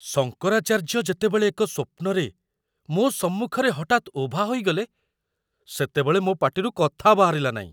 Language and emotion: Odia, surprised